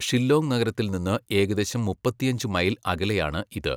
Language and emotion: Malayalam, neutral